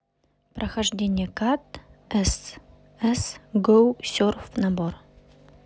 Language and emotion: Russian, neutral